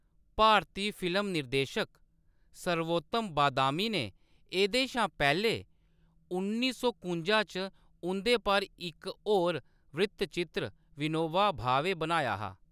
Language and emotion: Dogri, neutral